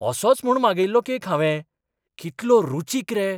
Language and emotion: Goan Konkani, surprised